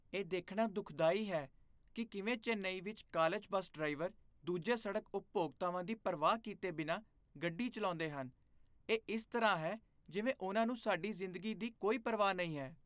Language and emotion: Punjabi, disgusted